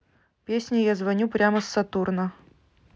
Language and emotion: Russian, neutral